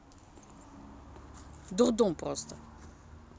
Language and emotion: Russian, neutral